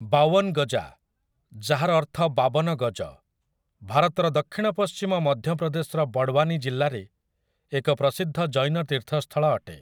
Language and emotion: Odia, neutral